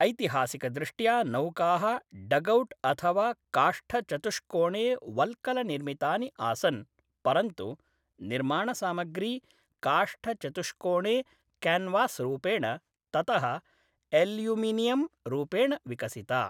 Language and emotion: Sanskrit, neutral